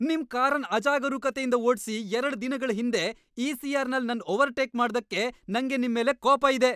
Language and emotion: Kannada, angry